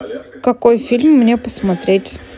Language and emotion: Russian, neutral